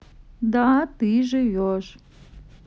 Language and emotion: Russian, neutral